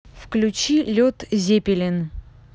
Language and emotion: Russian, neutral